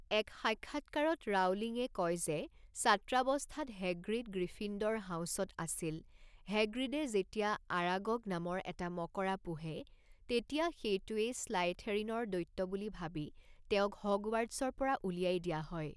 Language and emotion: Assamese, neutral